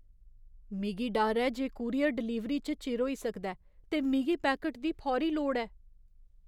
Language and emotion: Dogri, fearful